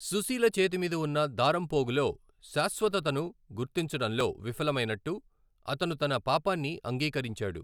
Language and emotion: Telugu, neutral